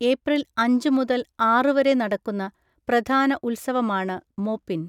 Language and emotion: Malayalam, neutral